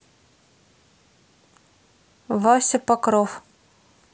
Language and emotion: Russian, neutral